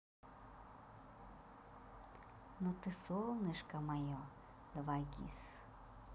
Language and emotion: Russian, positive